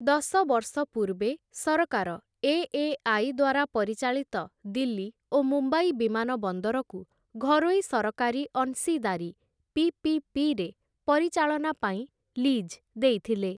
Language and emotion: Odia, neutral